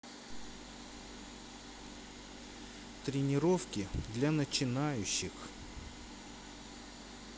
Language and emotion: Russian, neutral